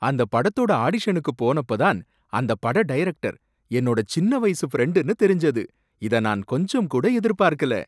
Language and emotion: Tamil, surprised